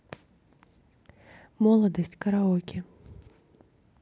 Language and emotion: Russian, neutral